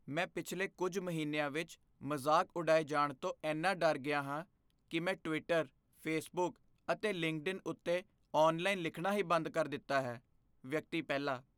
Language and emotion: Punjabi, fearful